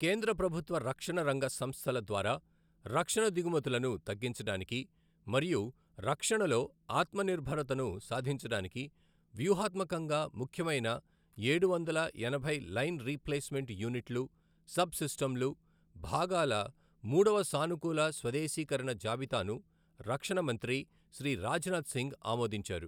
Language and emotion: Telugu, neutral